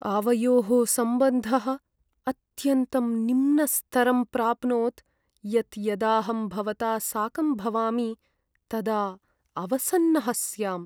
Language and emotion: Sanskrit, sad